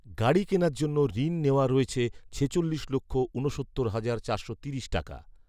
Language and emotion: Bengali, neutral